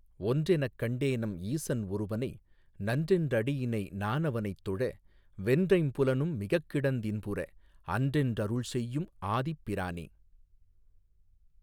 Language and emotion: Tamil, neutral